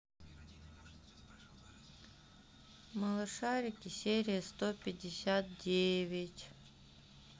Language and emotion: Russian, sad